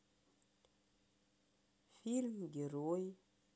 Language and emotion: Russian, sad